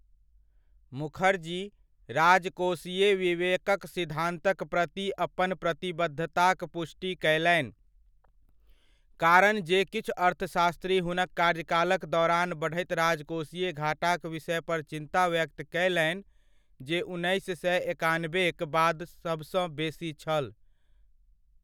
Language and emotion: Maithili, neutral